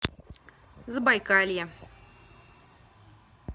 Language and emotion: Russian, neutral